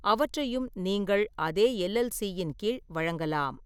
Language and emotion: Tamil, neutral